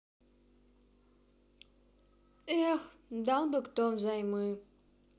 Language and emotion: Russian, sad